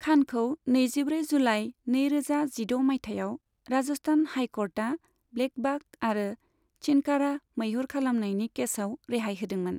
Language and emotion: Bodo, neutral